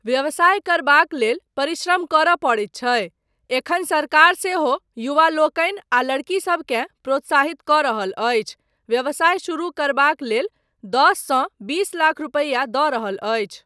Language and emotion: Maithili, neutral